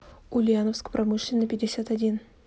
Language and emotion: Russian, neutral